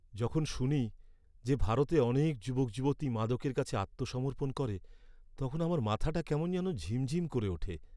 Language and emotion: Bengali, sad